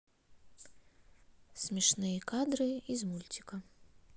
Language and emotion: Russian, neutral